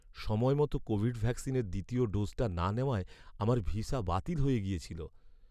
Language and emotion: Bengali, sad